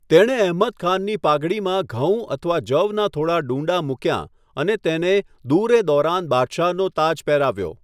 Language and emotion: Gujarati, neutral